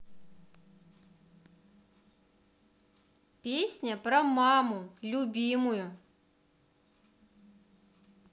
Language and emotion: Russian, positive